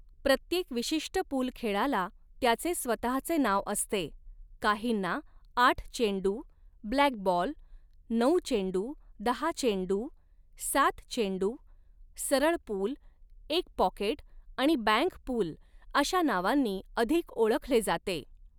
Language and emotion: Marathi, neutral